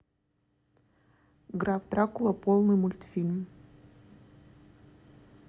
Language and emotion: Russian, neutral